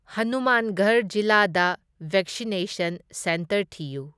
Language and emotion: Manipuri, neutral